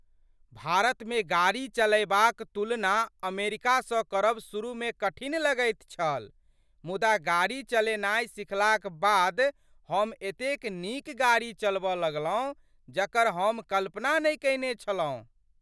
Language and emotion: Maithili, surprised